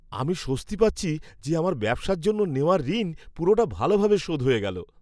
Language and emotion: Bengali, happy